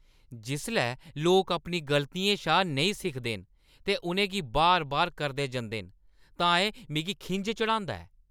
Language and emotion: Dogri, angry